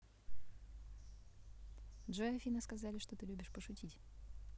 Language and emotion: Russian, neutral